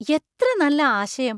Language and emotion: Malayalam, surprised